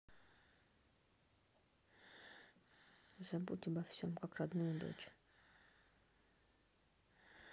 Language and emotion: Russian, neutral